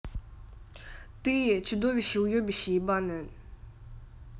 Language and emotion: Russian, angry